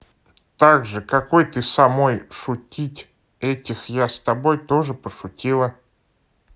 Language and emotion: Russian, neutral